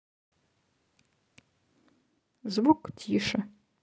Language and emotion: Russian, neutral